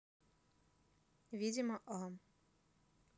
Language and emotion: Russian, neutral